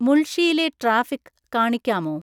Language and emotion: Malayalam, neutral